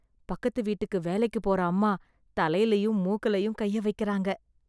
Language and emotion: Tamil, disgusted